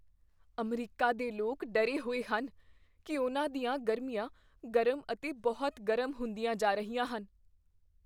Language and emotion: Punjabi, fearful